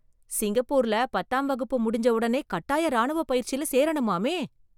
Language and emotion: Tamil, surprised